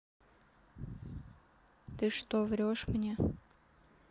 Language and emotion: Russian, sad